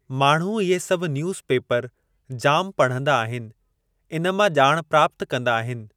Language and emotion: Sindhi, neutral